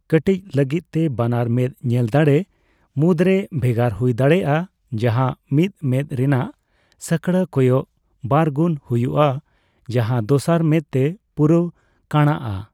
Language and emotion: Santali, neutral